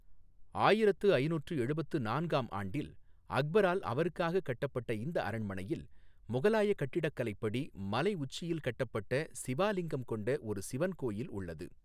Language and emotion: Tamil, neutral